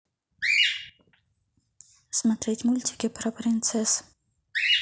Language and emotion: Russian, neutral